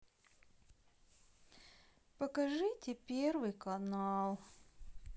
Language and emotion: Russian, sad